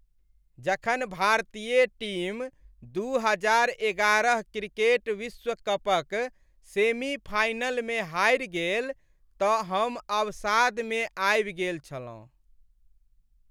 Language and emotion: Maithili, sad